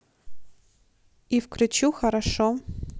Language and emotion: Russian, neutral